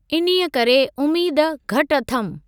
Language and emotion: Sindhi, neutral